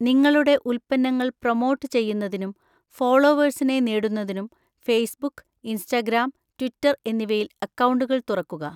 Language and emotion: Malayalam, neutral